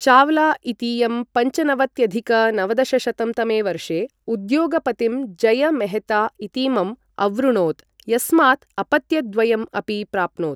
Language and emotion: Sanskrit, neutral